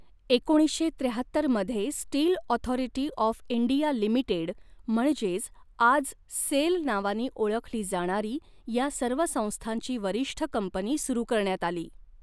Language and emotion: Marathi, neutral